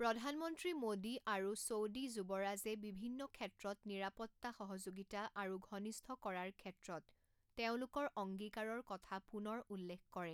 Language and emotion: Assamese, neutral